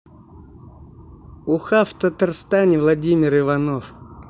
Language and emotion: Russian, neutral